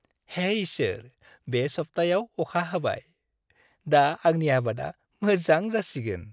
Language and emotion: Bodo, happy